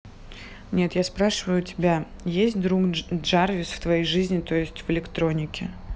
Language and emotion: Russian, neutral